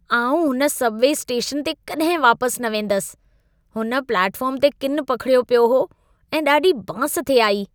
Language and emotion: Sindhi, disgusted